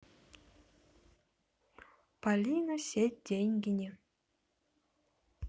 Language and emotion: Russian, neutral